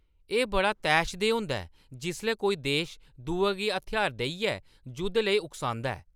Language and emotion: Dogri, angry